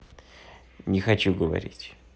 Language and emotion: Russian, sad